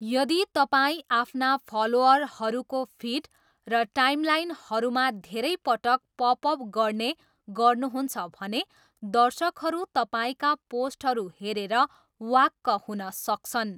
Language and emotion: Nepali, neutral